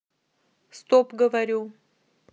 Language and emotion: Russian, neutral